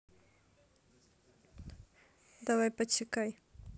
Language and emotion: Russian, neutral